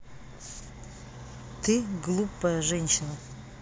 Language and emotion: Russian, neutral